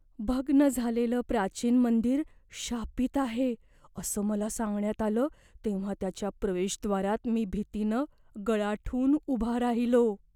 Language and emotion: Marathi, fearful